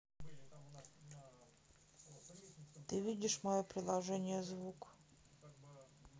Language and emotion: Russian, neutral